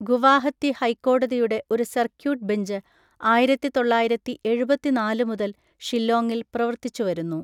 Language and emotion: Malayalam, neutral